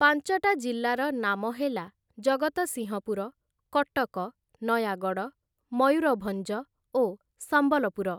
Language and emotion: Odia, neutral